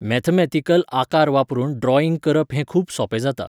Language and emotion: Goan Konkani, neutral